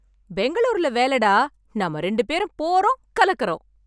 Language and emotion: Tamil, happy